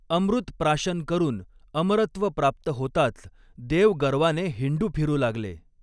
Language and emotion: Marathi, neutral